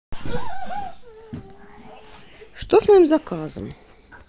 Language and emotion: Russian, neutral